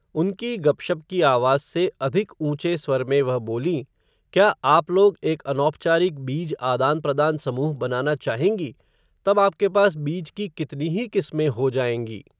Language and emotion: Hindi, neutral